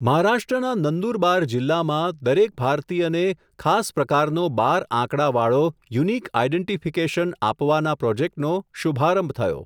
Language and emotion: Gujarati, neutral